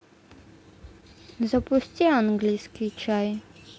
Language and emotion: Russian, neutral